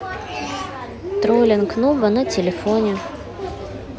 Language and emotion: Russian, neutral